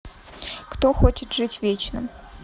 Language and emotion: Russian, neutral